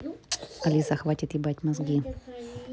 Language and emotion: Russian, neutral